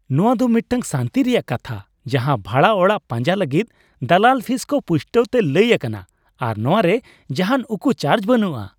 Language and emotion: Santali, happy